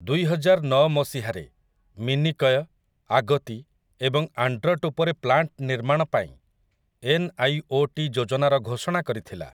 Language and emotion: Odia, neutral